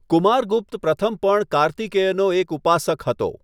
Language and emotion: Gujarati, neutral